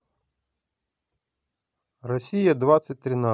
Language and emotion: Russian, neutral